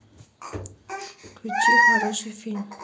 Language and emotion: Russian, neutral